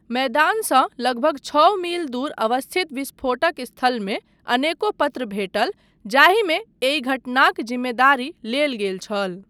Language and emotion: Maithili, neutral